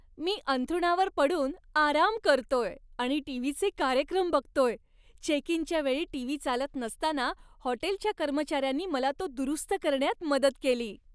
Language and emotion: Marathi, happy